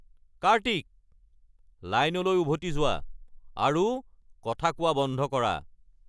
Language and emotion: Assamese, angry